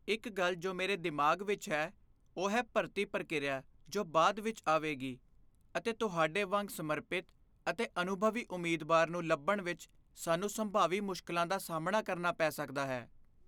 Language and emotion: Punjabi, fearful